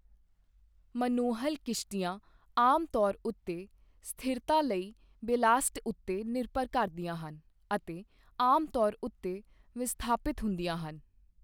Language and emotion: Punjabi, neutral